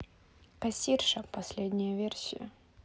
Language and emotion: Russian, neutral